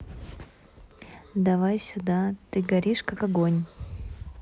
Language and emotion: Russian, neutral